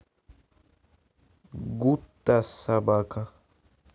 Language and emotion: Russian, neutral